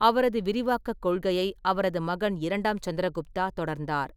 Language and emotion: Tamil, neutral